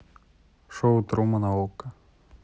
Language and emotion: Russian, neutral